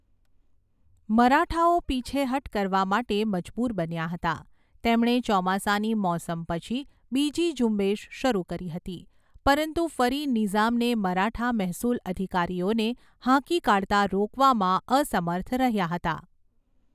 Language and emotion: Gujarati, neutral